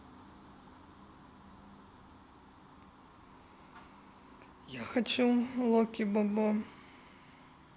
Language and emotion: Russian, sad